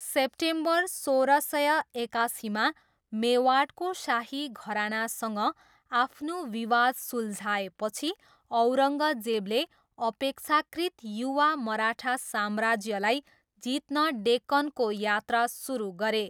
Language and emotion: Nepali, neutral